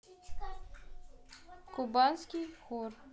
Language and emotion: Russian, neutral